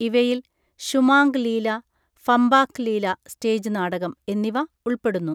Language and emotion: Malayalam, neutral